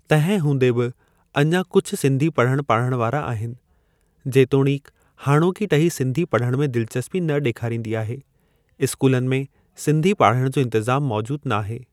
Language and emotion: Sindhi, neutral